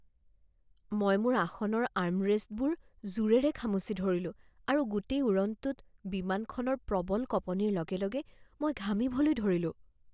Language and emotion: Assamese, fearful